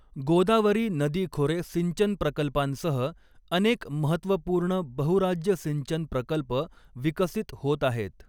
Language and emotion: Marathi, neutral